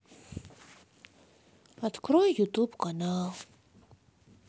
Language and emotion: Russian, sad